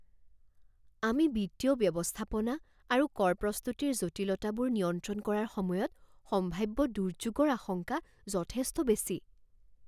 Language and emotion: Assamese, fearful